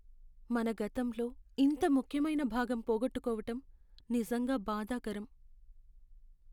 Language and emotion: Telugu, sad